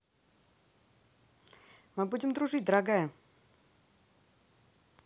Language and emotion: Russian, positive